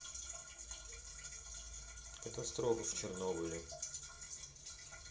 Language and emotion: Russian, neutral